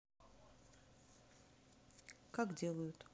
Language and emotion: Russian, neutral